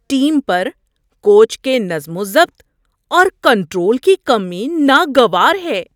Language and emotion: Urdu, disgusted